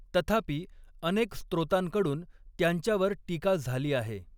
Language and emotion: Marathi, neutral